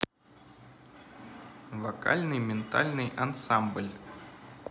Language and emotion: Russian, neutral